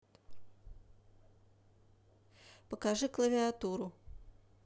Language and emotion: Russian, neutral